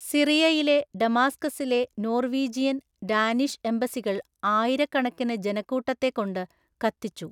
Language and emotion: Malayalam, neutral